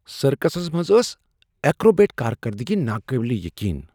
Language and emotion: Kashmiri, surprised